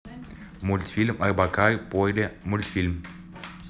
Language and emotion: Russian, neutral